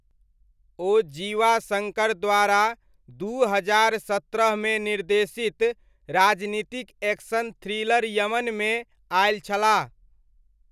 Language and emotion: Maithili, neutral